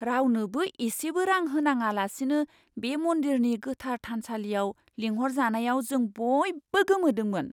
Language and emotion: Bodo, surprised